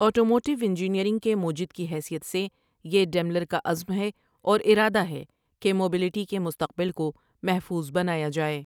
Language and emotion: Urdu, neutral